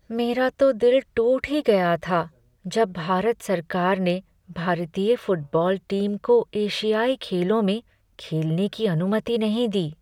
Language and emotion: Hindi, sad